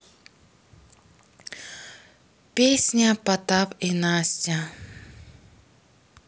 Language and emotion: Russian, sad